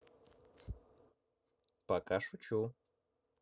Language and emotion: Russian, neutral